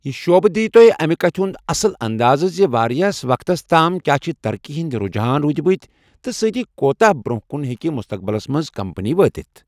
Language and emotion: Kashmiri, neutral